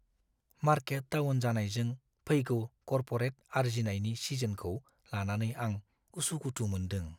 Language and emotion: Bodo, fearful